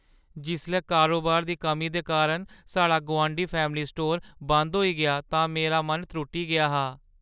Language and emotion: Dogri, sad